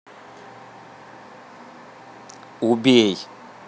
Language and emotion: Russian, angry